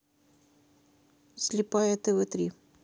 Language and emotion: Russian, neutral